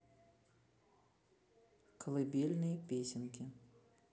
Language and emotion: Russian, neutral